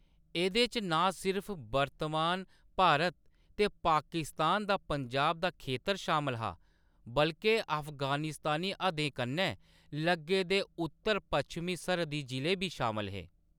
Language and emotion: Dogri, neutral